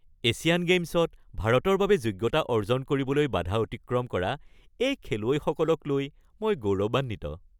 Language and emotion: Assamese, happy